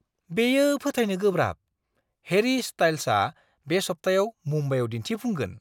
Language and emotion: Bodo, surprised